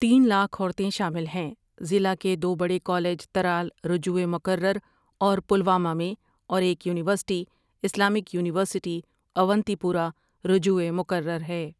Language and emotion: Urdu, neutral